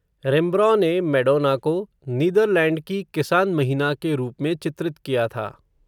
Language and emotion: Hindi, neutral